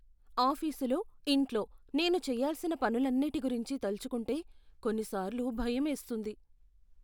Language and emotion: Telugu, fearful